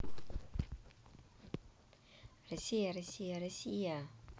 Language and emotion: Russian, positive